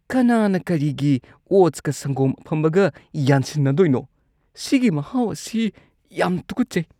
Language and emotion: Manipuri, disgusted